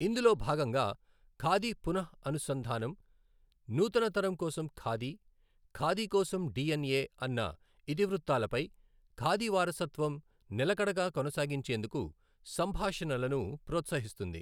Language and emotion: Telugu, neutral